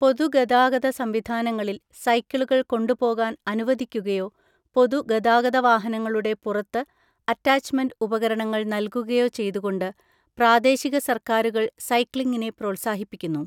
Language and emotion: Malayalam, neutral